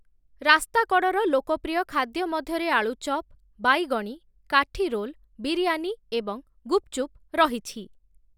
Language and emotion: Odia, neutral